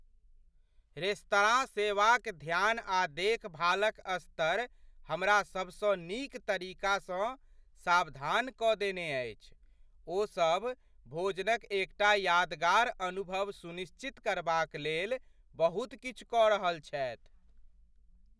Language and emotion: Maithili, surprised